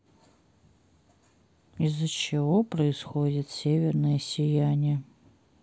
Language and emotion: Russian, sad